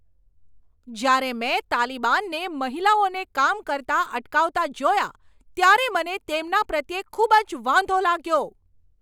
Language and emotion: Gujarati, angry